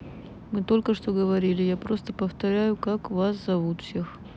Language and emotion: Russian, neutral